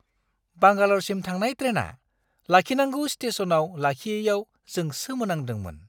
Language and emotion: Bodo, surprised